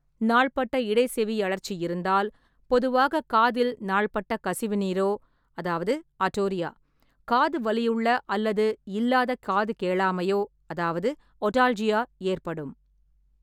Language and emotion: Tamil, neutral